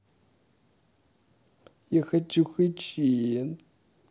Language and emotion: Russian, sad